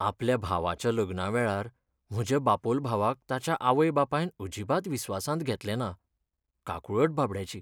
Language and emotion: Goan Konkani, sad